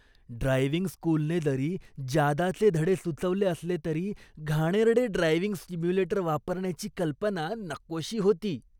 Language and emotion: Marathi, disgusted